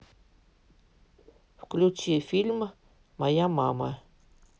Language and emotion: Russian, neutral